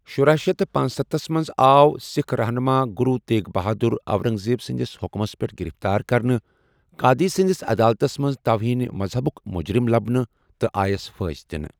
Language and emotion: Kashmiri, neutral